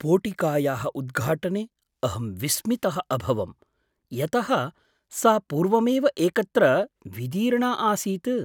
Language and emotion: Sanskrit, surprised